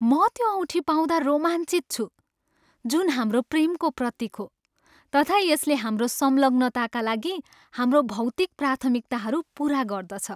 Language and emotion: Nepali, happy